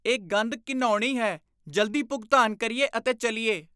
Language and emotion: Punjabi, disgusted